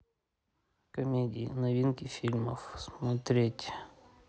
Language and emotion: Russian, neutral